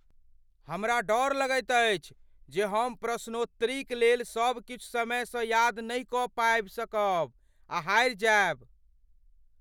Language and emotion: Maithili, fearful